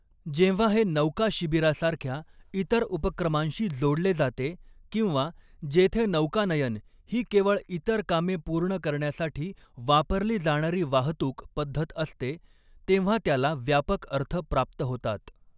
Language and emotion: Marathi, neutral